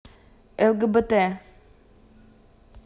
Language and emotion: Russian, neutral